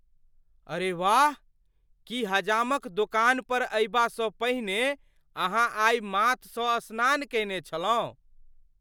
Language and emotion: Maithili, surprised